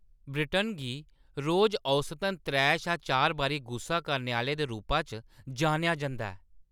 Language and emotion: Dogri, angry